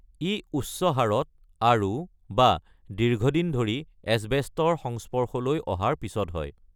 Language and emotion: Assamese, neutral